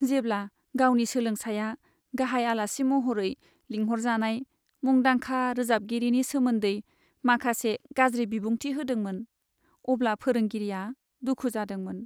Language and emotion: Bodo, sad